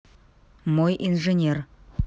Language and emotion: Russian, neutral